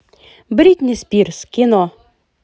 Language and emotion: Russian, positive